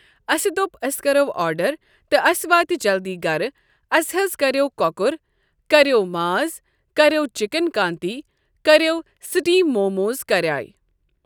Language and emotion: Kashmiri, neutral